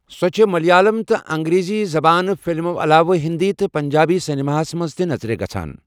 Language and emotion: Kashmiri, neutral